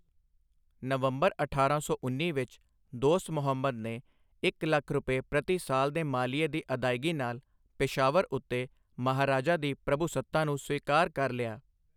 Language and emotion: Punjabi, neutral